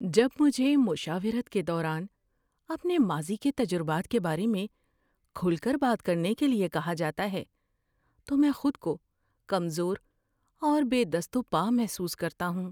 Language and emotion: Urdu, fearful